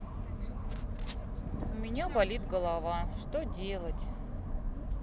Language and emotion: Russian, sad